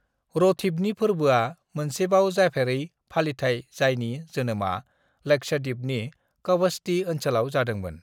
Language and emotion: Bodo, neutral